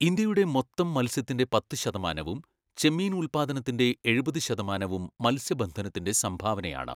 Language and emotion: Malayalam, neutral